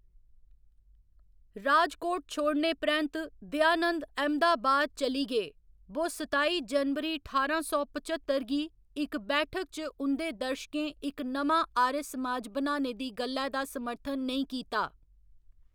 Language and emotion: Dogri, neutral